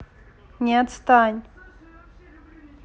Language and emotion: Russian, neutral